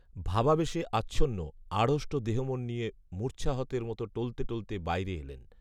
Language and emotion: Bengali, neutral